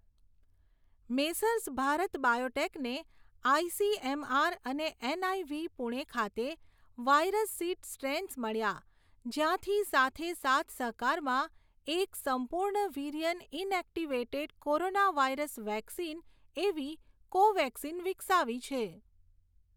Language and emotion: Gujarati, neutral